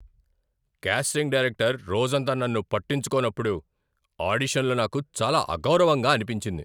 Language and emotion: Telugu, angry